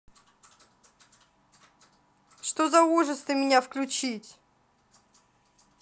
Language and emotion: Russian, angry